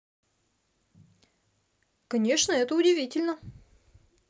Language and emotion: Russian, neutral